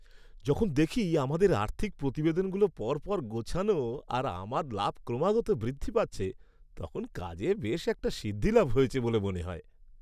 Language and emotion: Bengali, happy